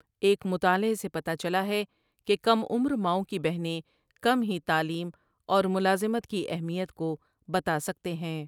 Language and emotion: Urdu, neutral